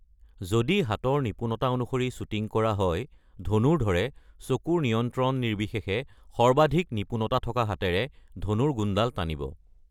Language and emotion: Assamese, neutral